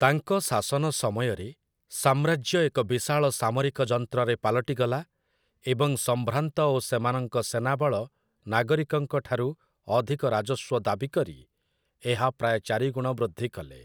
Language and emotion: Odia, neutral